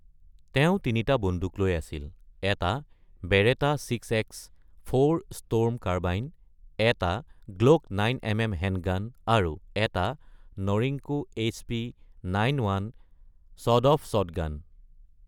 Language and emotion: Assamese, neutral